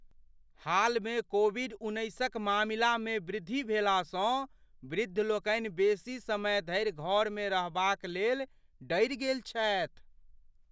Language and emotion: Maithili, fearful